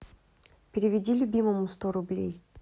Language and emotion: Russian, neutral